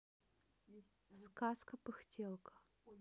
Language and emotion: Russian, neutral